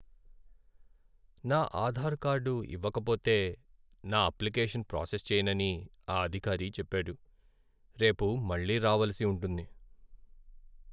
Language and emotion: Telugu, sad